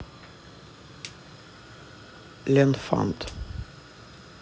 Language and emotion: Russian, neutral